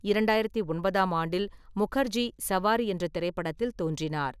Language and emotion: Tamil, neutral